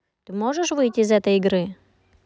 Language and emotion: Russian, neutral